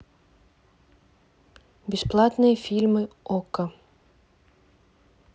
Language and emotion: Russian, neutral